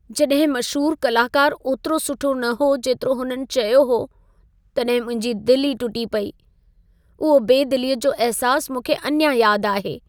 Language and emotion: Sindhi, sad